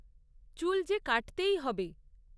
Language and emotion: Bengali, neutral